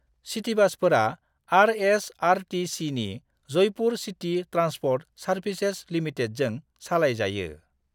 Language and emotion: Bodo, neutral